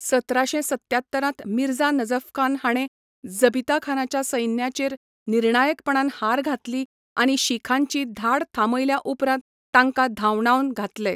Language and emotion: Goan Konkani, neutral